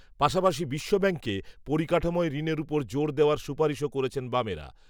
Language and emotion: Bengali, neutral